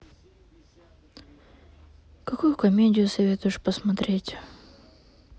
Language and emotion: Russian, sad